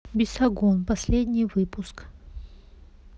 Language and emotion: Russian, neutral